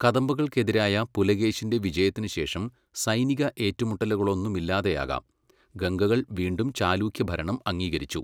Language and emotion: Malayalam, neutral